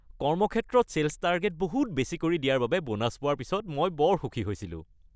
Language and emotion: Assamese, happy